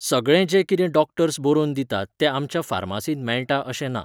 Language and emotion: Goan Konkani, neutral